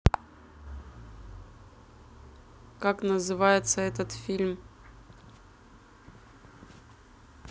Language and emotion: Russian, neutral